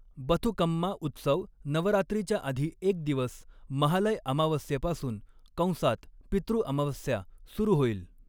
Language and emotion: Marathi, neutral